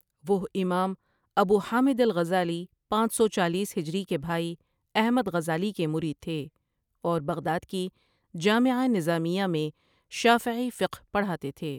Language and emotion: Urdu, neutral